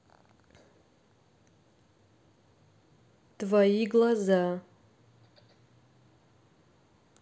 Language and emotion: Russian, neutral